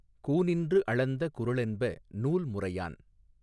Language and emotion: Tamil, neutral